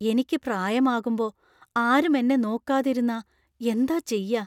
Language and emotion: Malayalam, fearful